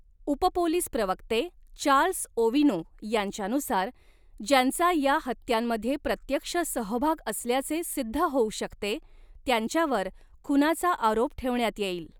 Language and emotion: Marathi, neutral